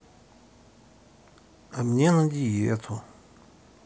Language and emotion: Russian, sad